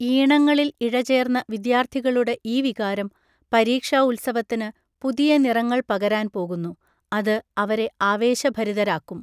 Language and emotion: Malayalam, neutral